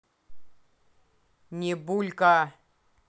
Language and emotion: Russian, angry